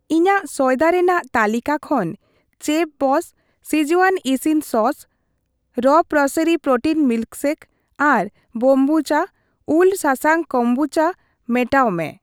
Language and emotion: Santali, neutral